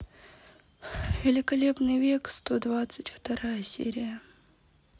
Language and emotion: Russian, sad